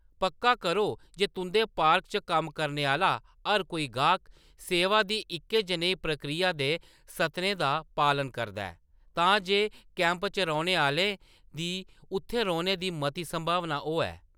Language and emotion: Dogri, neutral